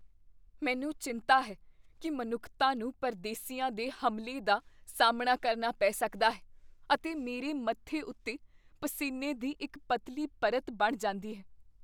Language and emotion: Punjabi, fearful